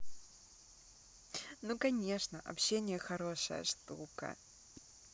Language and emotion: Russian, positive